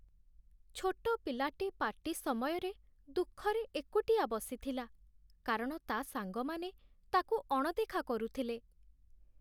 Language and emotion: Odia, sad